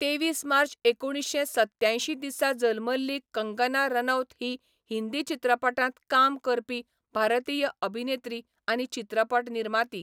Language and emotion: Goan Konkani, neutral